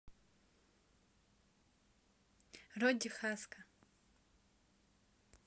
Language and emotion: Russian, neutral